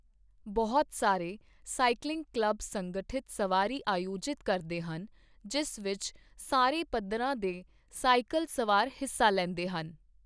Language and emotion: Punjabi, neutral